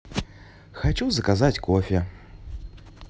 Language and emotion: Russian, neutral